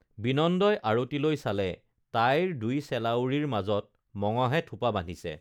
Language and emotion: Assamese, neutral